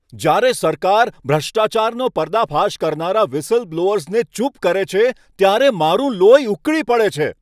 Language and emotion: Gujarati, angry